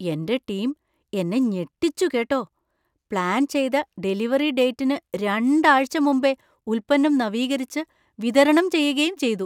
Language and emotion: Malayalam, surprised